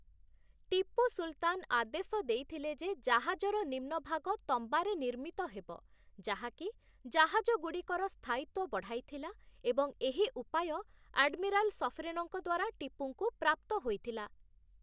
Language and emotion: Odia, neutral